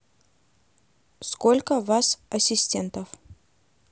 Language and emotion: Russian, neutral